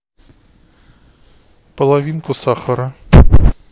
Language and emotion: Russian, neutral